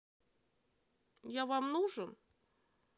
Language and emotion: Russian, neutral